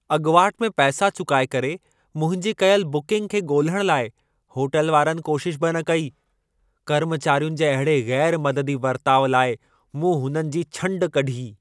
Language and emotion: Sindhi, angry